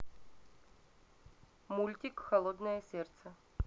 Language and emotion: Russian, neutral